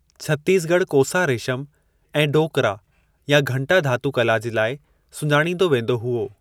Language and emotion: Sindhi, neutral